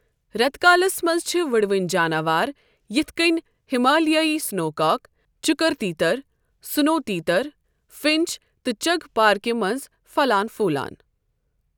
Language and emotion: Kashmiri, neutral